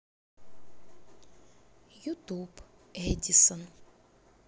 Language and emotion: Russian, neutral